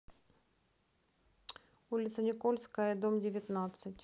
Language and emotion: Russian, neutral